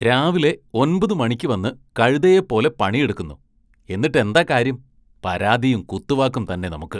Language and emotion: Malayalam, disgusted